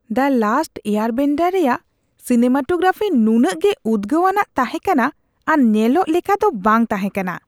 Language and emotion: Santali, disgusted